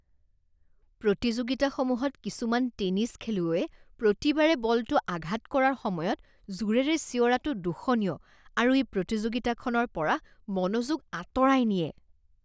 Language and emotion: Assamese, disgusted